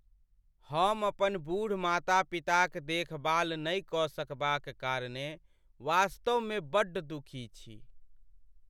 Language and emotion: Maithili, sad